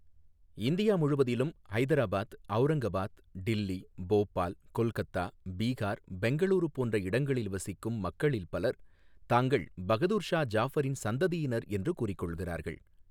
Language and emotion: Tamil, neutral